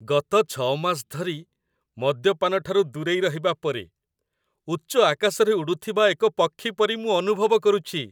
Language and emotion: Odia, happy